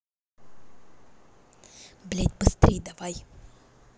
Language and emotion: Russian, angry